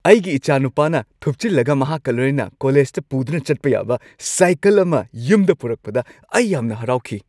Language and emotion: Manipuri, happy